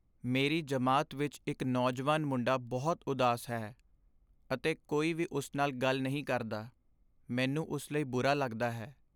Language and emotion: Punjabi, sad